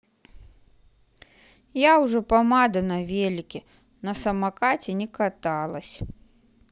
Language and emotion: Russian, sad